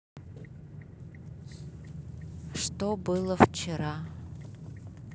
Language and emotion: Russian, neutral